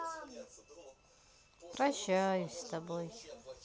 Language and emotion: Russian, sad